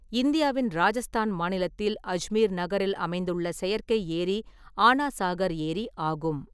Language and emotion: Tamil, neutral